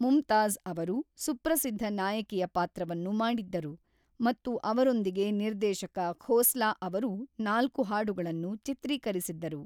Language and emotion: Kannada, neutral